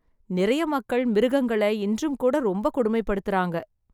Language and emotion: Tamil, sad